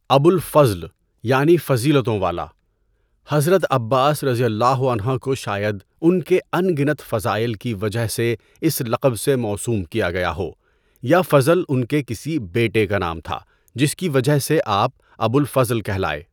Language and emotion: Urdu, neutral